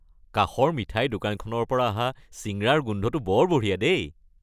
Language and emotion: Assamese, happy